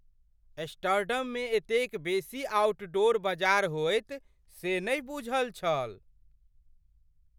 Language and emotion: Maithili, surprised